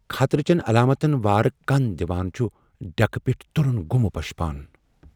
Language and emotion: Kashmiri, fearful